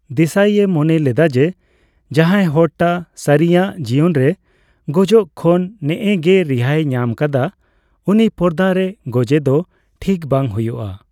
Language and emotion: Santali, neutral